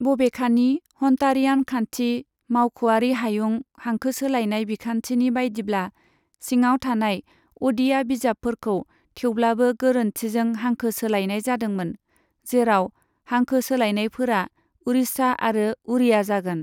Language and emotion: Bodo, neutral